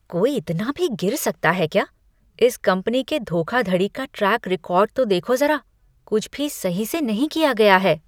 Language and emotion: Hindi, disgusted